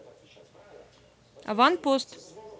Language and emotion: Russian, neutral